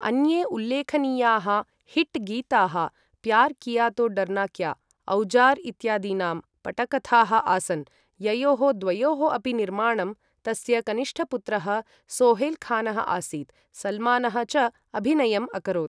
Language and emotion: Sanskrit, neutral